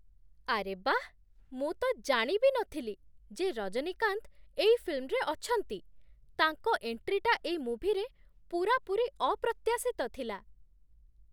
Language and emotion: Odia, surprised